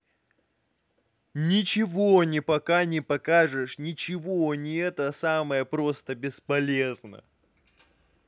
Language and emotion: Russian, angry